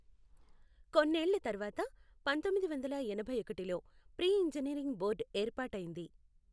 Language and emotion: Telugu, neutral